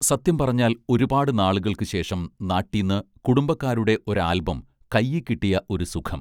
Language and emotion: Malayalam, neutral